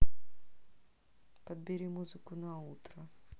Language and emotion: Russian, neutral